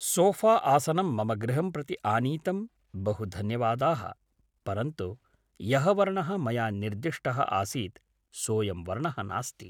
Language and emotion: Sanskrit, neutral